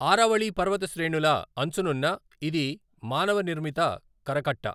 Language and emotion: Telugu, neutral